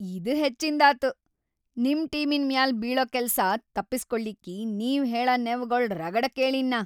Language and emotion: Kannada, angry